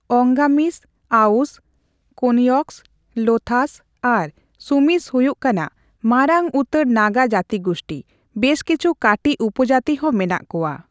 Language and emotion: Santali, neutral